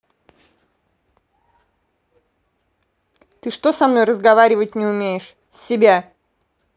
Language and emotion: Russian, angry